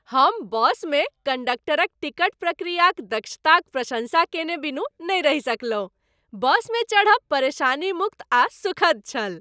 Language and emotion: Maithili, happy